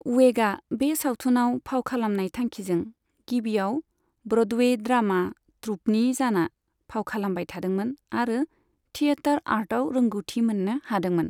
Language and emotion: Bodo, neutral